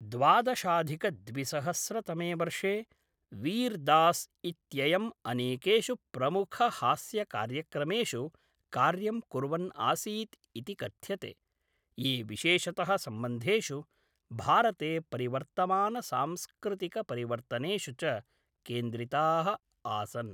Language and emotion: Sanskrit, neutral